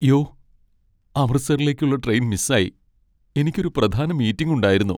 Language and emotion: Malayalam, sad